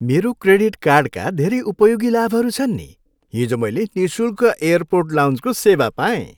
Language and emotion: Nepali, happy